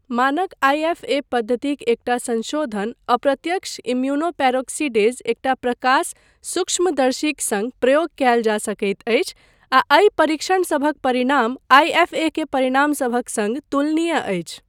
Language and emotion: Maithili, neutral